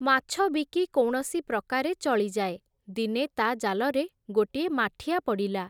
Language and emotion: Odia, neutral